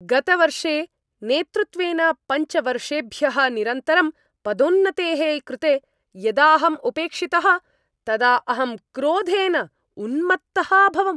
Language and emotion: Sanskrit, angry